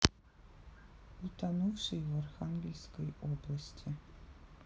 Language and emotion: Russian, sad